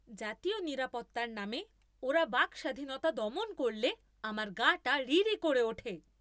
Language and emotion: Bengali, angry